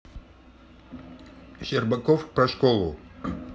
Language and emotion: Russian, neutral